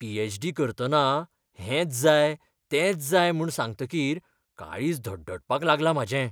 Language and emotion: Goan Konkani, fearful